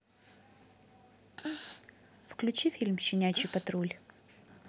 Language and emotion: Russian, neutral